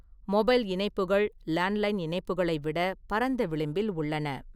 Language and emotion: Tamil, neutral